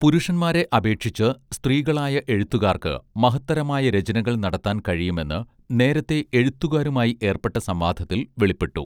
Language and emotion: Malayalam, neutral